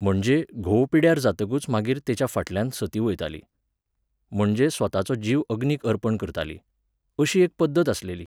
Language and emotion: Goan Konkani, neutral